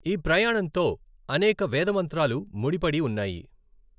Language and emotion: Telugu, neutral